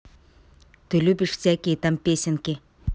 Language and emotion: Russian, neutral